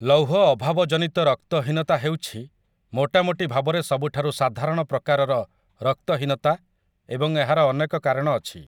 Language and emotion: Odia, neutral